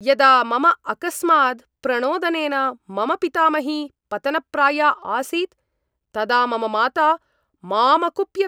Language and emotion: Sanskrit, angry